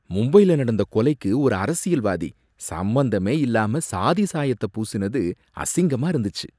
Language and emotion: Tamil, disgusted